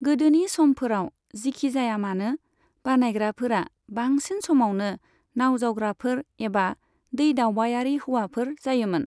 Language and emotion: Bodo, neutral